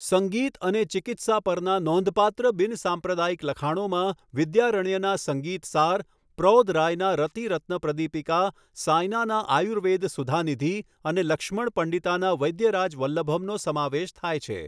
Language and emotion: Gujarati, neutral